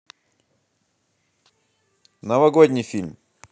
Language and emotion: Russian, positive